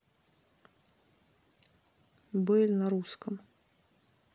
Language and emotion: Russian, neutral